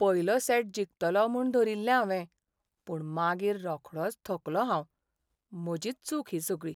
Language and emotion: Goan Konkani, sad